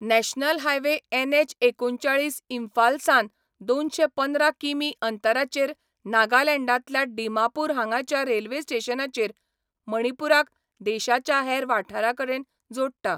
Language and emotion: Goan Konkani, neutral